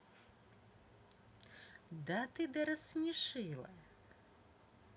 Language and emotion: Russian, positive